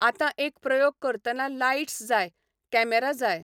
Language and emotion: Goan Konkani, neutral